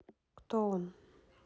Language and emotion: Russian, neutral